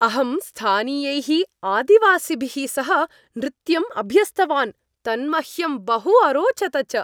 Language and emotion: Sanskrit, happy